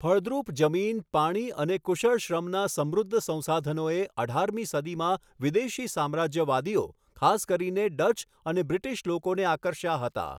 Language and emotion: Gujarati, neutral